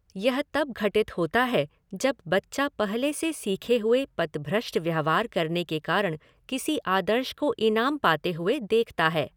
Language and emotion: Hindi, neutral